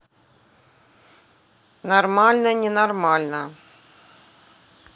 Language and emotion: Russian, neutral